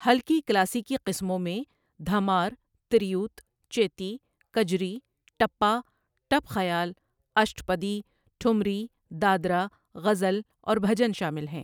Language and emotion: Urdu, neutral